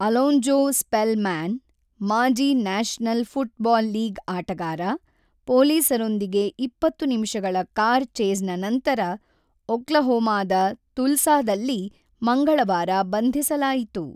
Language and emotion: Kannada, neutral